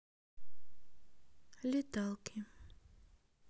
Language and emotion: Russian, neutral